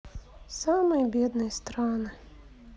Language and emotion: Russian, sad